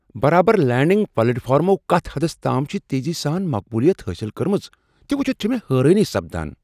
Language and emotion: Kashmiri, surprised